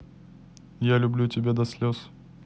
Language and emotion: Russian, neutral